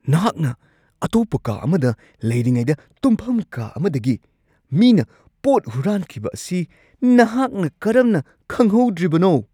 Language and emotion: Manipuri, surprised